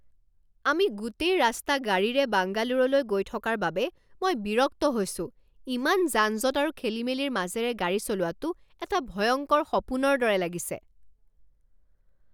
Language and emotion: Assamese, angry